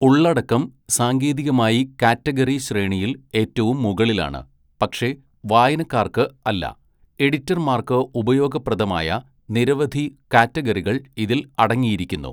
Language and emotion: Malayalam, neutral